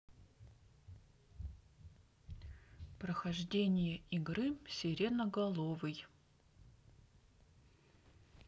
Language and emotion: Russian, neutral